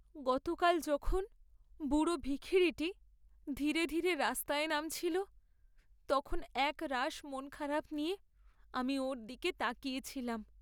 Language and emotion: Bengali, sad